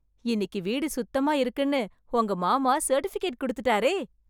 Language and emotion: Tamil, happy